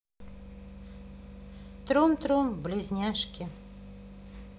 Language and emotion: Russian, neutral